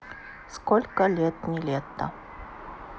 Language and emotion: Russian, neutral